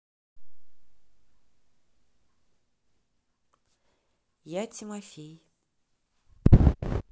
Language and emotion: Russian, neutral